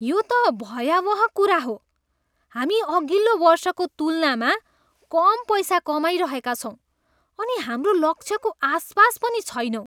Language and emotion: Nepali, disgusted